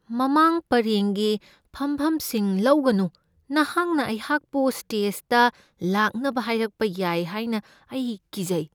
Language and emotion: Manipuri, fearful